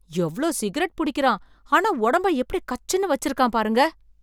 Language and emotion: Tamil, surprised